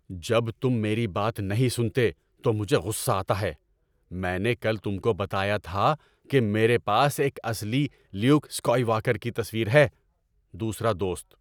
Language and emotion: Urdu, angry